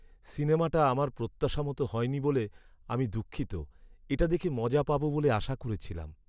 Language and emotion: Bengali, sad